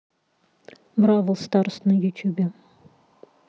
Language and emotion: Russian, neutral